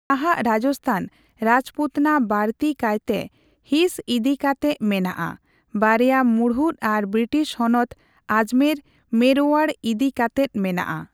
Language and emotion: Santali, neutral